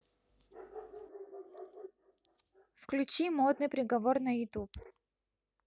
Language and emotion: Russian, neutral